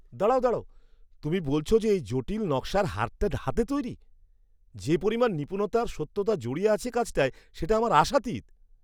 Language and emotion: Bengali, surprised